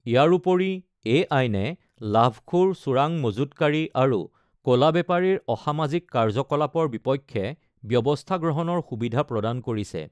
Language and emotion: Assamese, neutral